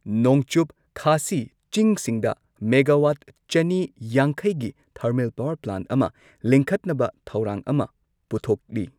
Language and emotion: Manipuri, neutral